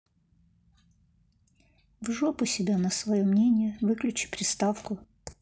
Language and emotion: Russian, neutral